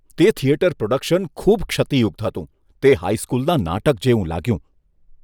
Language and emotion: Gujarati, disgusted